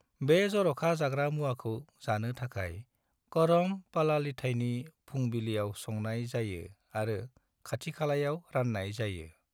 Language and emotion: Bodo, neutral